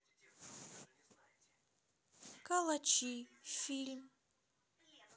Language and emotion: Russian, neutral